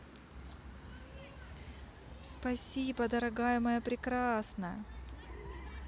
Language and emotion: Russian, positive